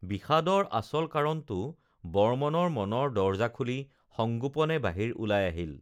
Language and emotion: Assamese, neutral